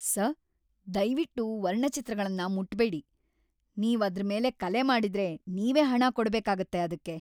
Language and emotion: Kannada, angry